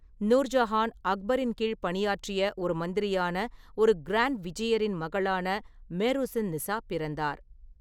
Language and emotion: Tamil, neutral